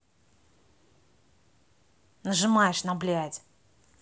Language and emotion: Russian, angry